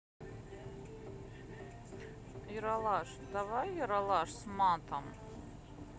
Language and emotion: Russian, neutral